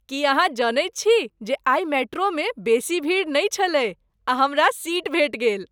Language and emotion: Maithili, happy